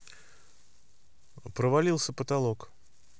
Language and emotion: Russian, neutral